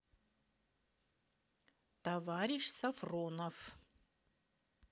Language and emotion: Russian, neutral